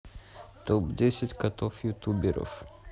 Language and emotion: Russian, neutral